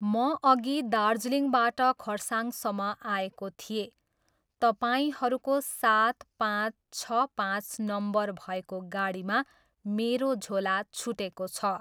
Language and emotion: Nepali, neutral